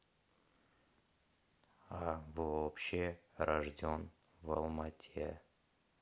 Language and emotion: Russian, neutral